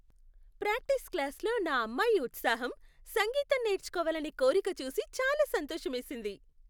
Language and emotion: Telugu, happy